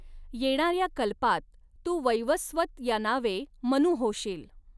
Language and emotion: Marathi, neutral